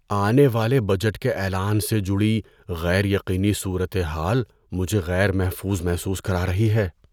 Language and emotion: Urdu, fearful